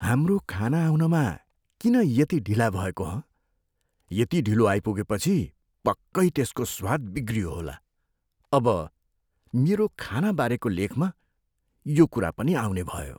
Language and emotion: Nepali, fearful